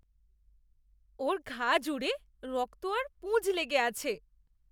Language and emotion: Bengali, disgusted